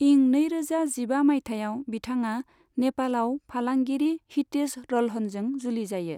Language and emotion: Bodo, neutral